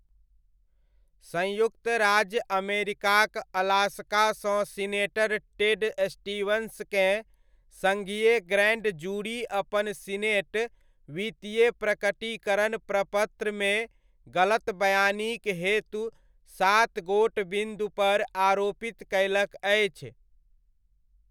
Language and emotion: Maithili, neutral